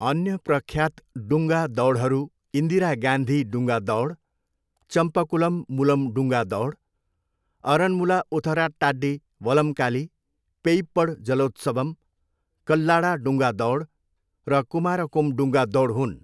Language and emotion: Nepali, neutral